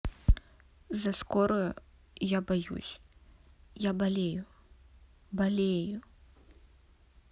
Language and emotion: Russian, sad